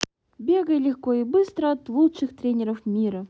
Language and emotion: Russian, positive